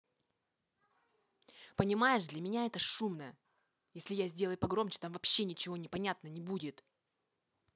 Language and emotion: Russian, angry